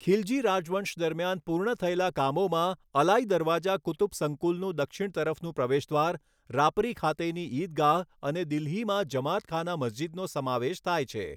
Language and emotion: Gujarati, neutral